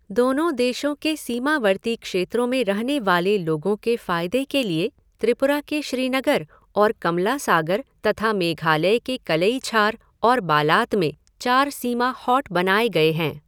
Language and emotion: Hindi, neutral